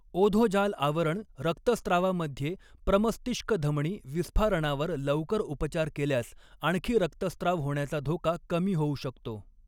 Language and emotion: Marathi, neutral